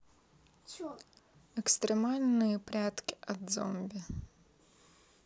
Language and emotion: Russian, neutral